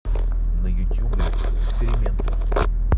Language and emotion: Russian, neutral